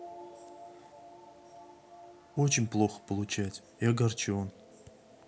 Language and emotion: Russian, sad